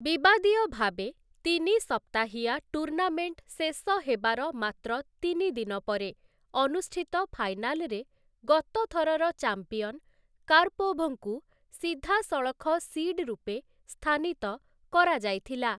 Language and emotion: Odia, neutral